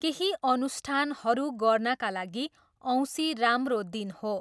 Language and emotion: Nepali, neutral